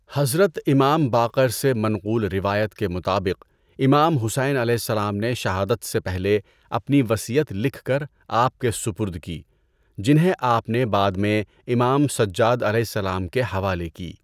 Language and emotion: Urdu, neutral